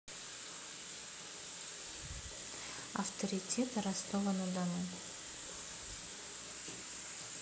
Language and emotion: Russian, neutral